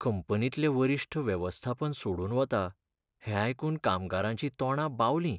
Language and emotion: Goan Konkani, sad